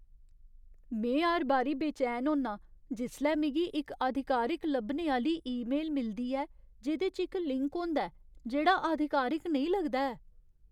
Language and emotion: Dogri, fearful